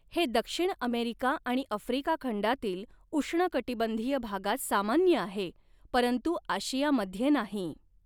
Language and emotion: Marathi, neutral